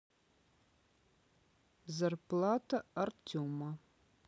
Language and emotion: Russian, neutral